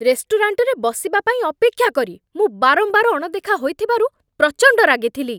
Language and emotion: Odia, angry